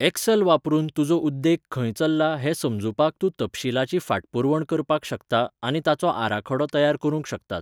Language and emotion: Goan Konkani, neutral